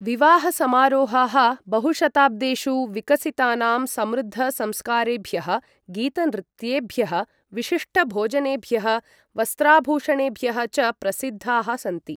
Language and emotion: Sanskrit, neutral